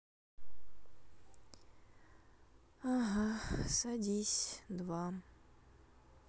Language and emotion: Russian, sad